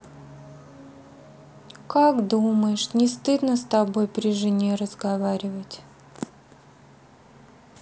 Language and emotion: Russian, sad